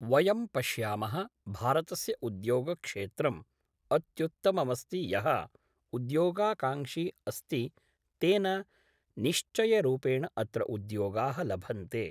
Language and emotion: Sanskrit, neutral